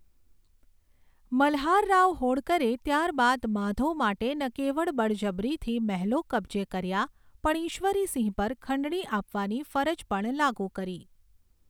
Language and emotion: Gujarati, neutral